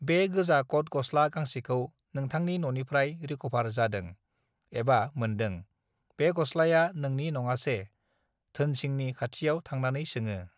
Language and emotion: Bodo, neutral